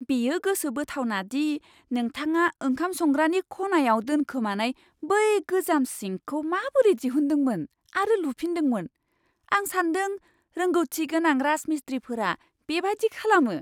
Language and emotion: Bodo, surprised